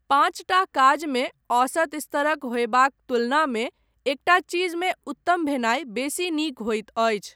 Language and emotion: Maithili, neutral